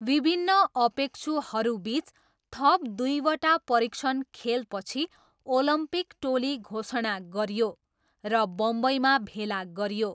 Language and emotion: Nepali, neutral